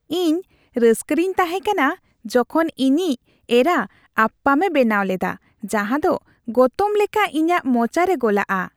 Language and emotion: Santali, happy